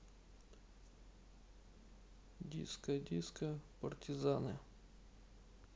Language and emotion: Russian, neutral